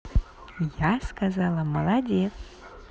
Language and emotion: Russian, positive